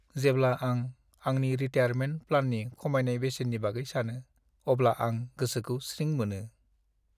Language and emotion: Bodo, sad